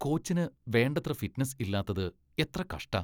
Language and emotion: Malayalam, disgusted